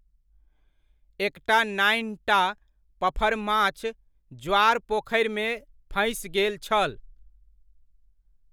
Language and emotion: Maithili, neutral